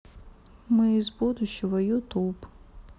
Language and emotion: Russian, neutral